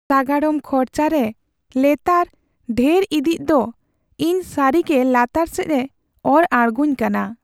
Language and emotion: Santali, sad